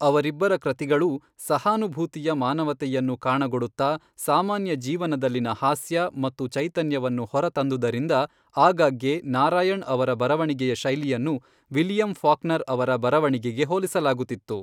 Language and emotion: Kannada, neutral